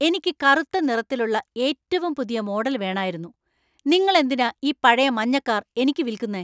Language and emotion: Malayalam, angry